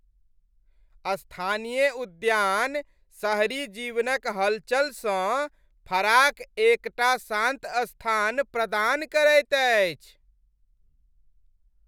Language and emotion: Maithili, happy